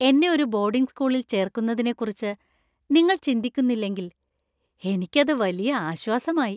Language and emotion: Malayalam, happy